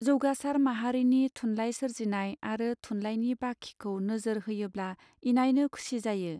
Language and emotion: Bodo, neutral